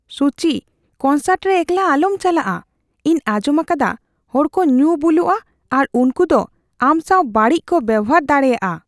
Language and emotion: Santali, fearful